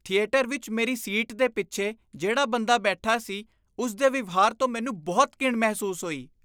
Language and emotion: Punjabi, disgusted